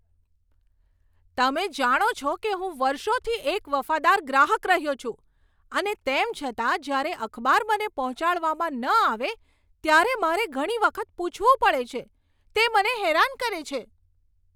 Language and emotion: Gujarati, angry